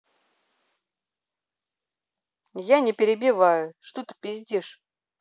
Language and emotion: Russian, angry